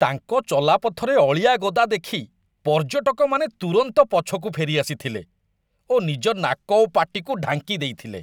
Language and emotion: Odia, disgusted